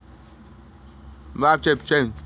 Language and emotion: Russian, neutral